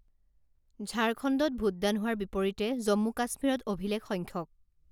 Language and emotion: Assamese, neutral